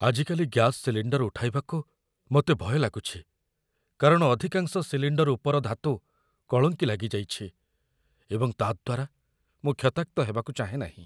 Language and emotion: Odia, fearful